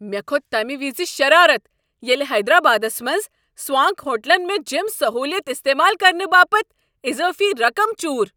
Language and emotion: Kashmiri, angry